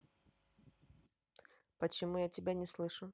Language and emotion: Russian, neutral